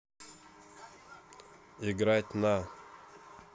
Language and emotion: Russian, neutral